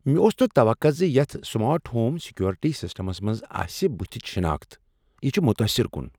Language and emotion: Kashmiri, surprised